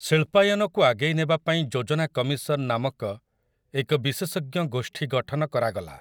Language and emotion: Odia, neutral